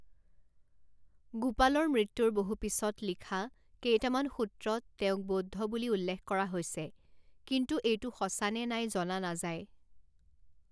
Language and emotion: Assamese, neutral